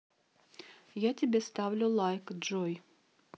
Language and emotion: Russian, neutral